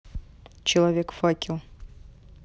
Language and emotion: Russian, neutral